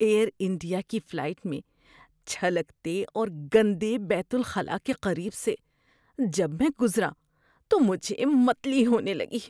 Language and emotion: Urdu, disgusted